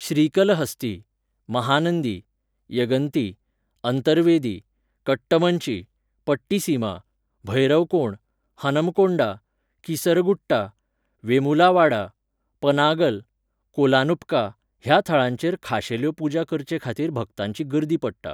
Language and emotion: Goan Konkani, neutral